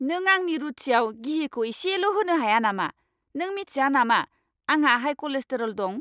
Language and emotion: Bodo, angry